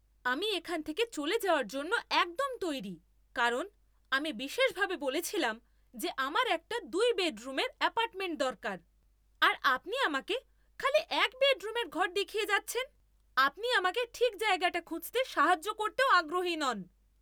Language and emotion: Bengali, angry